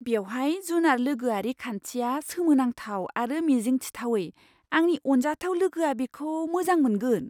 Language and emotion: Bodo, surprised